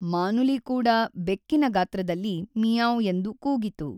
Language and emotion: Kannada, neutral